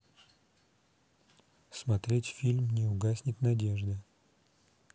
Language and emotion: Russian, neutral